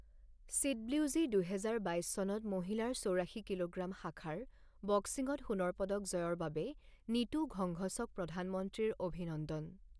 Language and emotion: Assamese, neutral